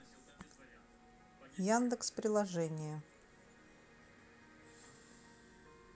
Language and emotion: Russian, neutral